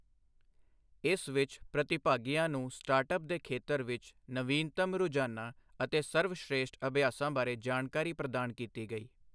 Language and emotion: Punjabi, neutral